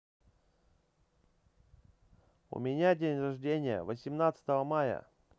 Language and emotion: Russian, neutral